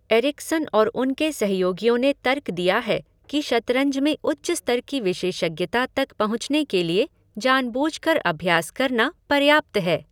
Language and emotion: Hindi, neutral